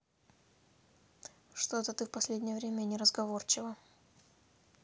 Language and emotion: Russian, neutral